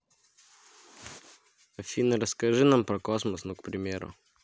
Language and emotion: Russian, neutral